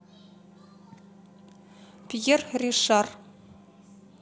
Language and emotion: Russian, neutral